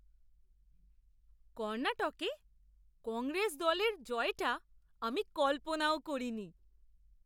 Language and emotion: Bengali, surprised